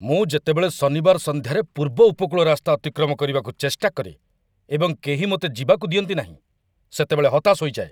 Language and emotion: Odia, angry